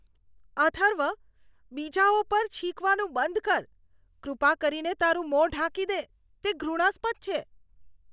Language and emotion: Gujarati, disgusted